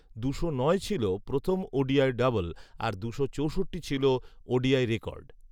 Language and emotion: Bengali, neutral